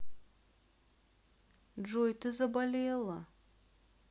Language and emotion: Russian, sad